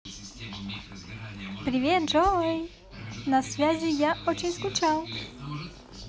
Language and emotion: Russian, positive